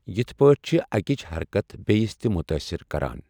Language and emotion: Kashmiri, neutral